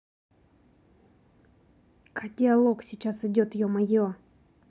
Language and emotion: Russian, angry